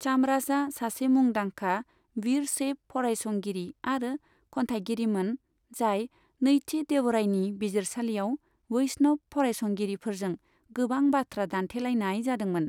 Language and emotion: Bodo, neutral